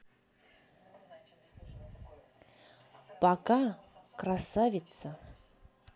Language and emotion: Russian, positive